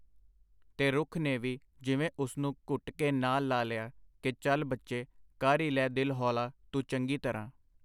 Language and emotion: Punjabi, neutral